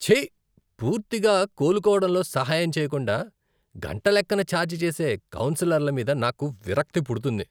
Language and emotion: Telugu, disgusted